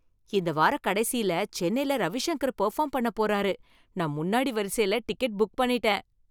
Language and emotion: Tamil, happy